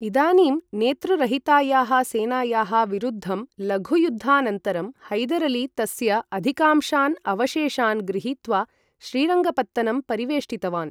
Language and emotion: Sanskrit, neutral